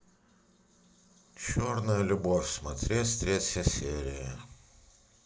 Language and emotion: Russian, neutral